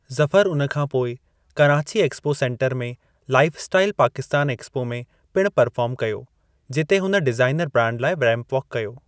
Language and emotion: Sindhi, neutral